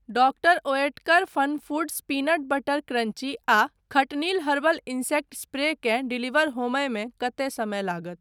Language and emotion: Maithili, neutral